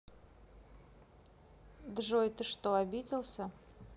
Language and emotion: Russian, neutral